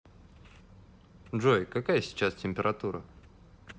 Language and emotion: Russian, neutral